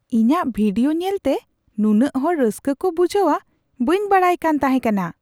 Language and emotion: Santali, surprised